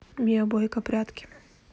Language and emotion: Russian, neutral